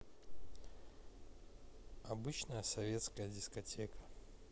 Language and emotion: Russian, neutral